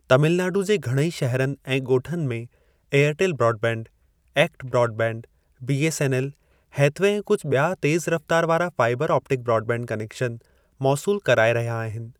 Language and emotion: Sindhi, neutral